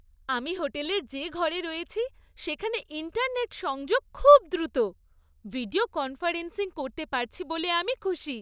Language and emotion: Bengali, happy